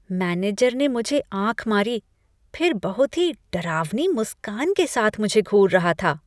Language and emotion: Hindi, disgusted